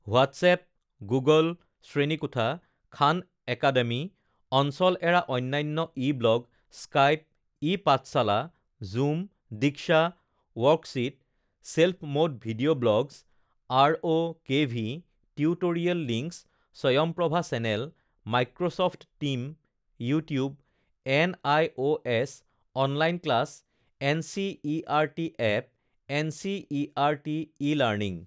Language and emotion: Assamese, neutral